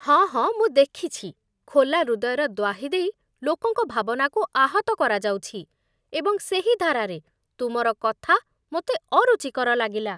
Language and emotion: Odia, disgusted